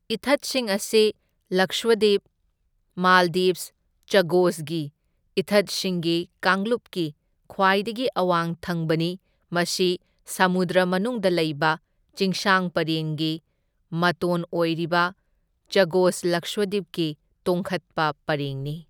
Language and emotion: Manipuri, neutral